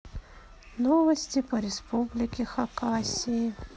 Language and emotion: Russian, sad